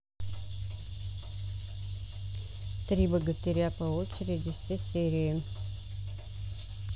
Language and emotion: Russian, neutral